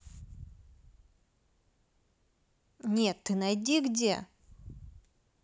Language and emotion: Russian, neutral